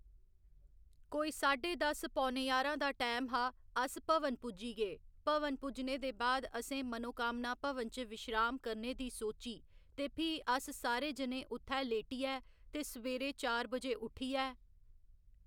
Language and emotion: Dogri, neutral